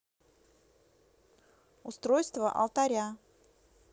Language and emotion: Russian, neutral